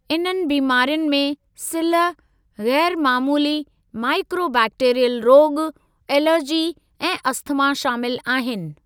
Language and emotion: Sindhi, neutral